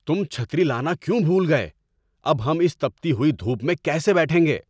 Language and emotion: Urdu, angry